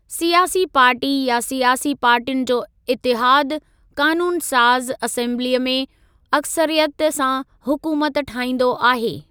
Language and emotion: Sindhi, neutral